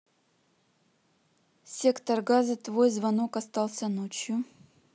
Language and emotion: Russian, neutral